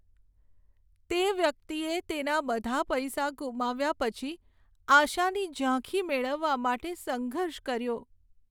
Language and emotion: Gujarati, sad